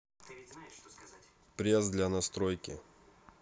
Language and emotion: Russian, neutral